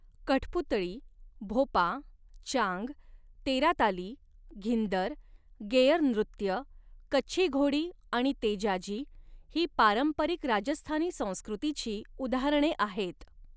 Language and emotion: Marathi, neutral